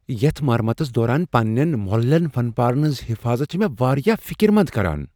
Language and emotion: Kashmiri, fearful